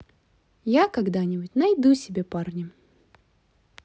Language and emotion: Russian, positive